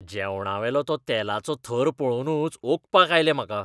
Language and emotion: Goan Konkani, disgusted